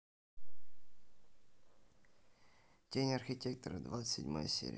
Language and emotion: Russian, neutral